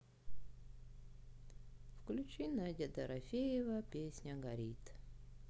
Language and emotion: Russian, sad